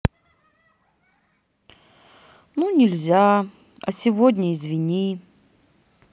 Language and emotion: Russian, sad